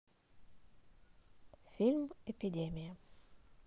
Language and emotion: Russian, neutral